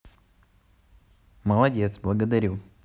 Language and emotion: Russian, positive